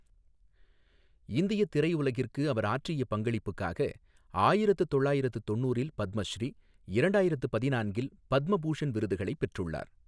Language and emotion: Tamil, neutral